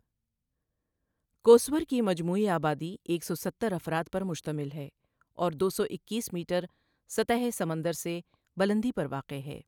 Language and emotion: Urdu, neutral